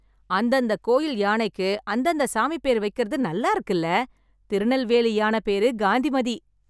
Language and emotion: Tamil, happy